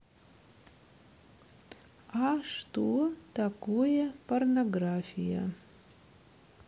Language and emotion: Russian, neutral